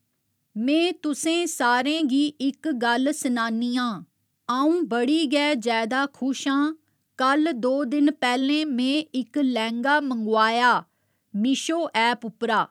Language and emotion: Dogri, neutral